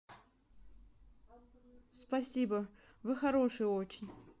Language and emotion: Russian, neutral